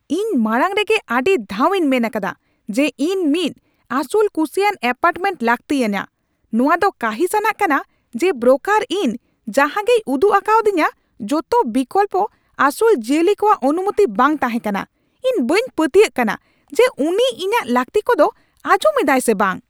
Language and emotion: Santali, angry